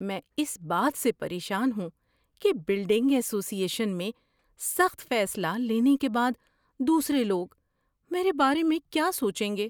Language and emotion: Urdu, fearful